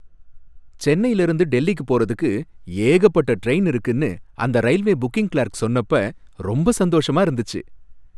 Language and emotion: Tamil, happy